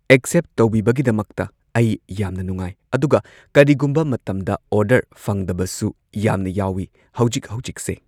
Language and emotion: Manipuri, neutral